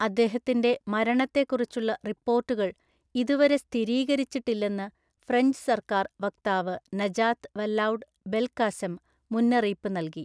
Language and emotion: Malayalam, neutral